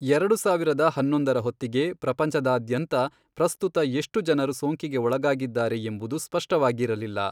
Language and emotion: Kannada, neutral